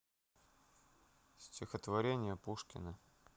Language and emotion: Russian, neutral